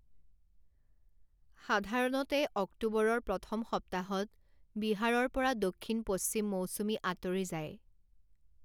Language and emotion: Assamese, neutral